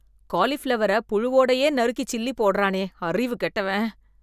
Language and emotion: Tamil, disgusted